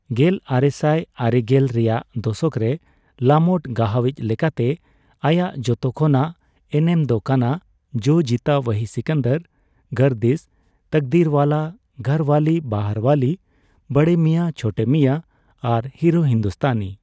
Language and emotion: Santali, neutral